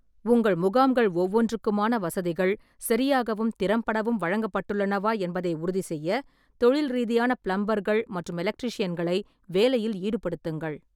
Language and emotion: Tamil, neutral